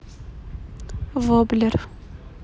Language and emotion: Russian, neutral